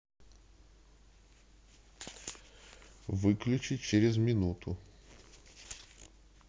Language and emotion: Russian, neutral